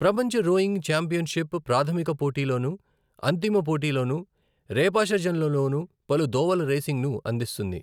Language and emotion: Telugu, neutral